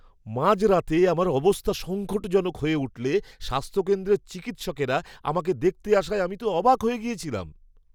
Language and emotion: Bengali, surprised